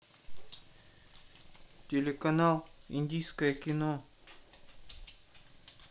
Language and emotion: Russian, neutral